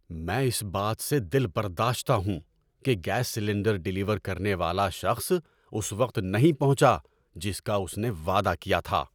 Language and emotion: Urdu, angry